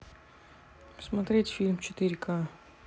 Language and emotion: Russian, neutral